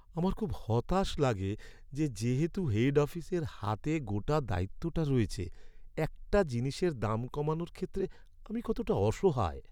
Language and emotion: Bengali, sad